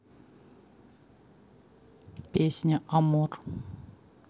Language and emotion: Russian, neutral